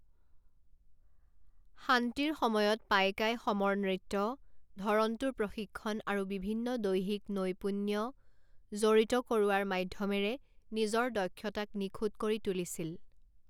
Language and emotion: Assamese, neutral